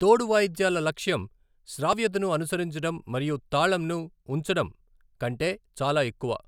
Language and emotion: Telugu, neutral